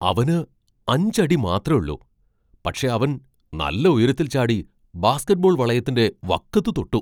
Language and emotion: Malayalam, surprised